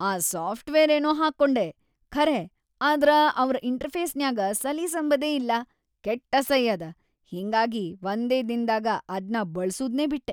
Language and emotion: Kannada, disgusted